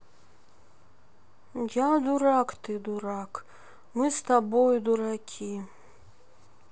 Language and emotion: Russian, sad